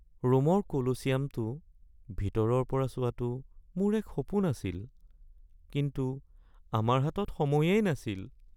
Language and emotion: Assamese, sad